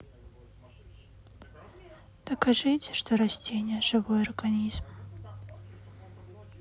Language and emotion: Russian, sad